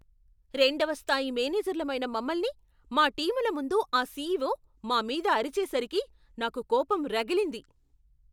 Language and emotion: Telugu, angry